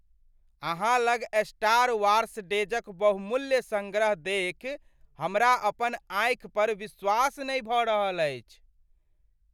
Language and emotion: Maithili, surprised